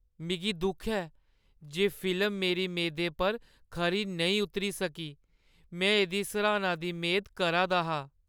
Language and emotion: Dogri, sad